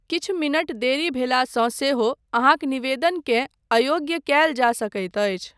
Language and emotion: Maithili, neutral